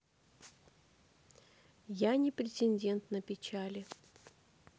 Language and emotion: Russian, sad